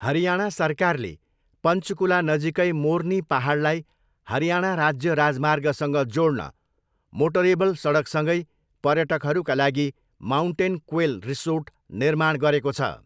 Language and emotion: Nepali, neutral